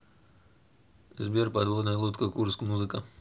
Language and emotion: Russian, neutral